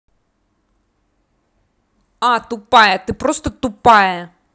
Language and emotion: Russian, angry